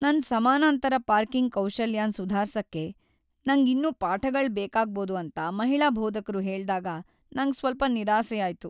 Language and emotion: Kannada, sad